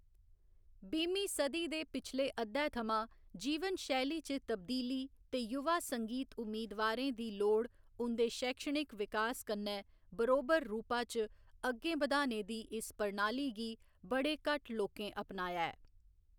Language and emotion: Dogri, neutral